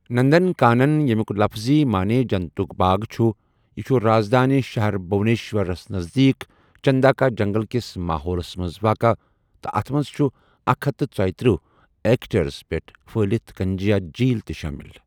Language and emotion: Kashmiri, neutral